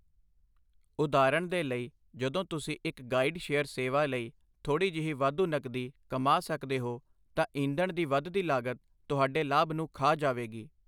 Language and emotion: Punjabi, neutral